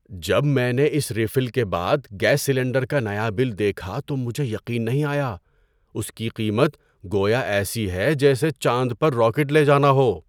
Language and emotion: Urdu, surprised